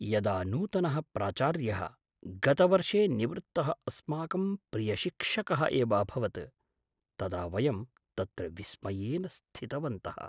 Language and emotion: Sanskrit, surprised